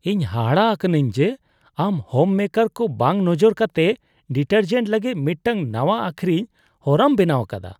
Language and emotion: Santali, disgusted